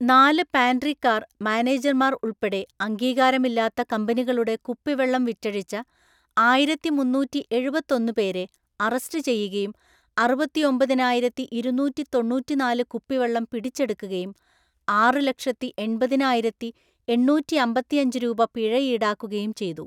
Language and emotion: Malayalam, neutral